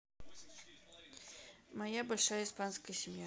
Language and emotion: Russian, neutral